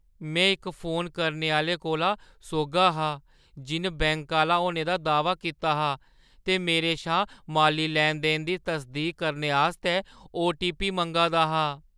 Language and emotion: Dogri, fearful